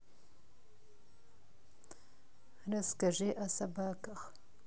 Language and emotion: Russian, neutral